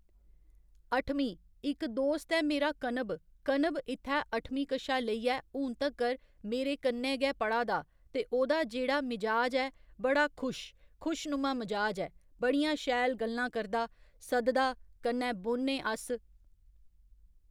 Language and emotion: Dogri, neutral